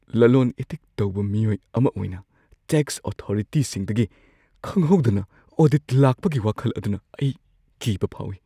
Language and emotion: Manipuri, fearful